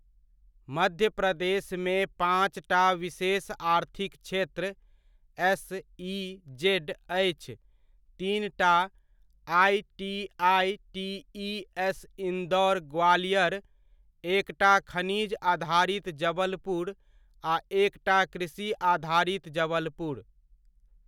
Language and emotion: Maithili, neutral